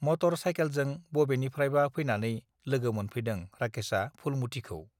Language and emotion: Bodo, neutral